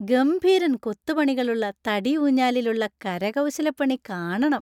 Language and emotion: Malayalam, happy